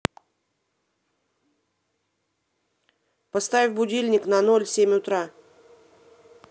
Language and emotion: Russian, angry